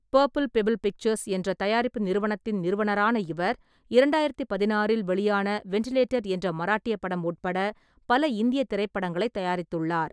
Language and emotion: Tamil, neutral